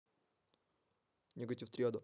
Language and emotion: Russian, neutral